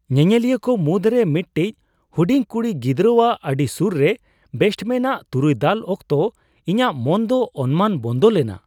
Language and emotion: Santali, surprised